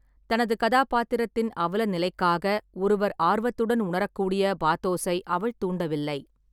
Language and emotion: Tamil, neutral